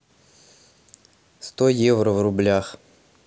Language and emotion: Russian, neutral